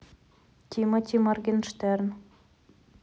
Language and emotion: Russian, neutral